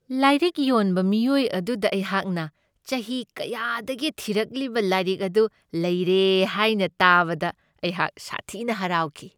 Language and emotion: Manipuri, happy